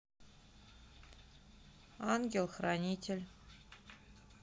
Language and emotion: Russian, neutral